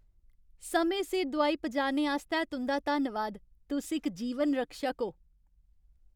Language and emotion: Dogri, happy